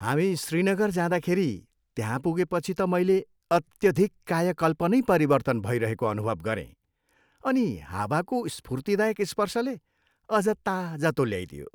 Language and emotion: Nepali, happy